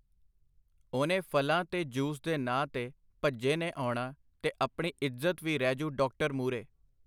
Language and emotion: Punjabi, neutral